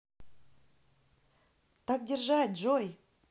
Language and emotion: Russian, positive